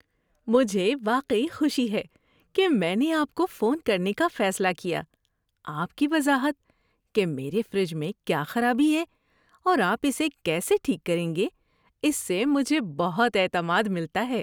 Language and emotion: Urdu, happy